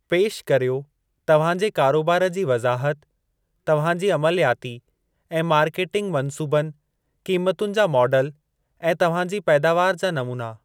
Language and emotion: Sindhi, neutral